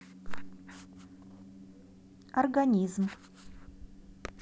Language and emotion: Russian, neutral